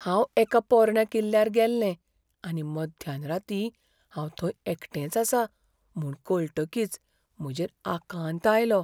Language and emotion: Goan Konkani, fearful